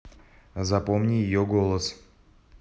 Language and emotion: Russian, neutral